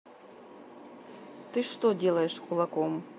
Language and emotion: Russian, angry